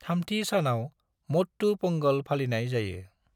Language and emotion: Bodo, neutral